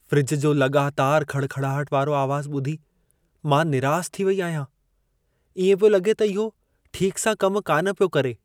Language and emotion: Sindhi, sad